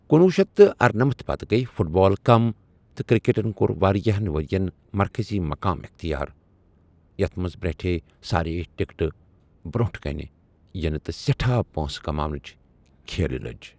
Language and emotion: Kashmiri, neutral